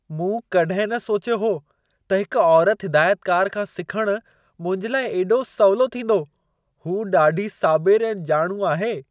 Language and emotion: Sindhi, surprised